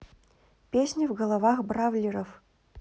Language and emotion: Russian, neutral